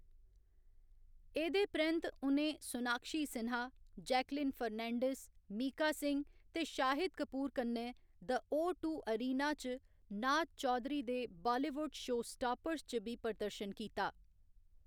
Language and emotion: Dogri, neutral